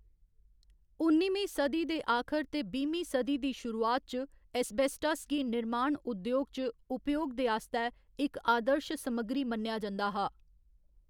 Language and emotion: Dogri, neutral